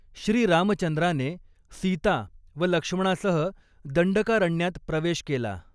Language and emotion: Marathi, neutral